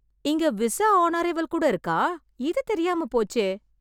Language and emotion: Tamil, surprised